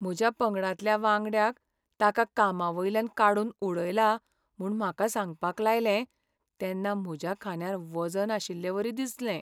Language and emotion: Goan Konkani, sad